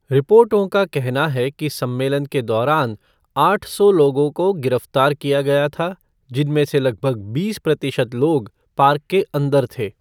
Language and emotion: Hindi, neutral